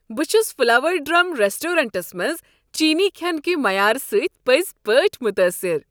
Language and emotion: Kashmiri, happy